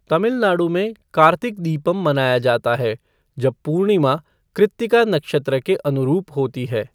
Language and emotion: Hindi, neutral